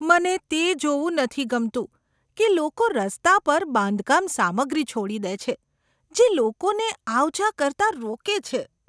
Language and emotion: Gujarati, disgusted